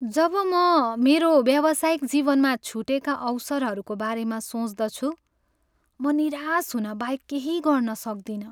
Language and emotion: Nepali, sad